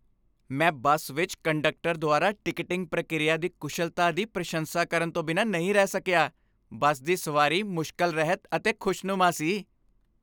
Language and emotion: Punjabi, happy